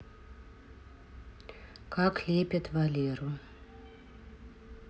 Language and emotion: Russian, neutral